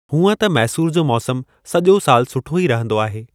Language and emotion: Sindhi, neutral